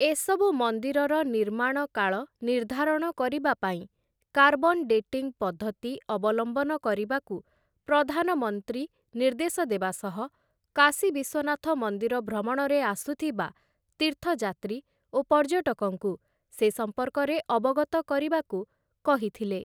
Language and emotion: Odia, neutral